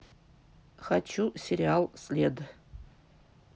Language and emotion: Russian, neutral